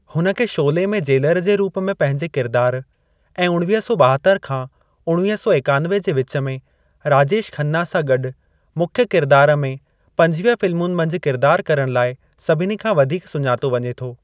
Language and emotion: Sindhi, neutral